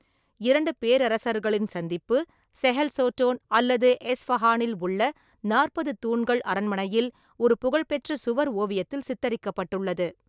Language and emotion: Tamil, neutral